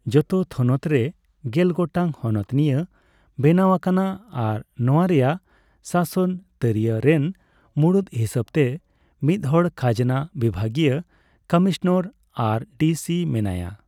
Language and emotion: Santali, neutral